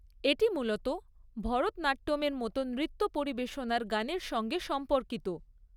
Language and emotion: Bengali, neutral